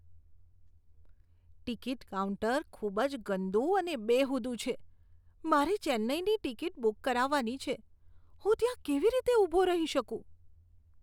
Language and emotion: Gujarati, disgusted